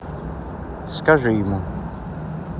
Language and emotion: Russian, neutral